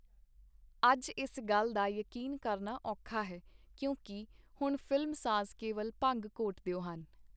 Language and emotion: Punjabi, neutral